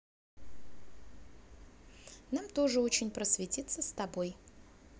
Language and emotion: Russian, neutral